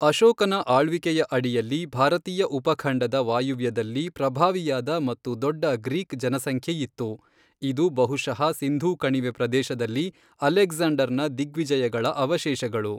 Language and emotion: Kannada, neutral